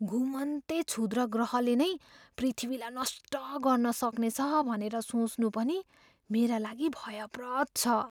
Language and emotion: Nepali, fearful